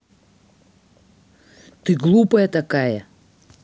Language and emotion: Russian, angry